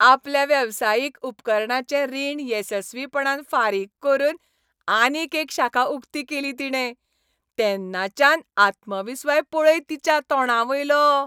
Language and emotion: Goan Konkani, happy